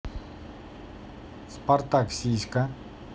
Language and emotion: Russian, neutral